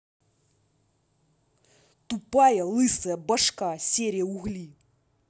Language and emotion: Russian, angry